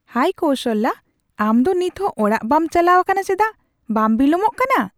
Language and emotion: Santali, surprised